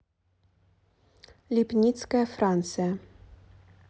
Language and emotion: Russian, neutral